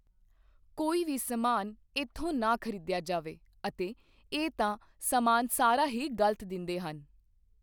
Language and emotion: Punjabi, neutral